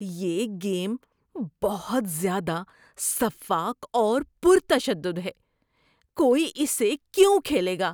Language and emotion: Urdu, disgusted